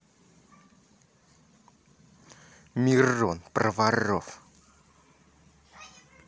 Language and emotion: Russian, angry